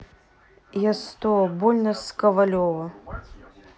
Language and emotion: Russian, neutral